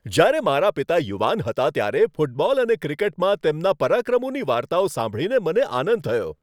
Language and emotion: Gujarati, happy